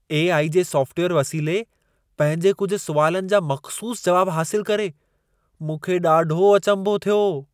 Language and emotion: Sindhi, surprised